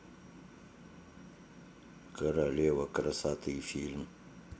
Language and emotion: Russian, neutral